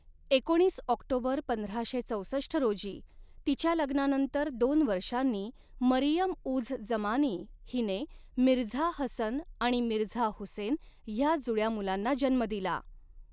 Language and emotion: Marathi, neutral